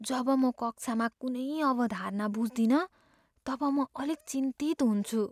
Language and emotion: Nepali, fearful